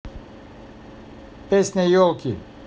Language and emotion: Russian, neutral